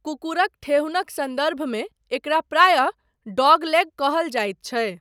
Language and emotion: Maithili, neutral